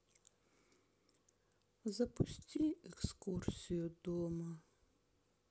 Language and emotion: Russian, sad